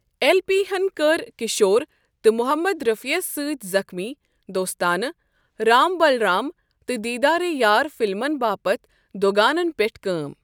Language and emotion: Kashmiri, neutral